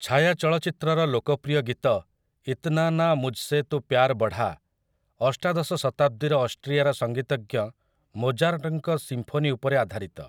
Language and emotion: Odia, neutral